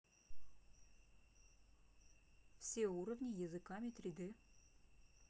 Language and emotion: Russian, neutral